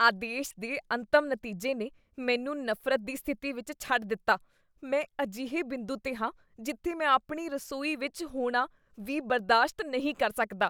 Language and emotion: Punjabi, disgusted